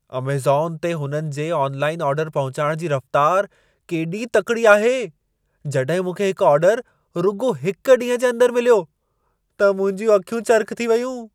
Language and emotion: Sindhi, surprised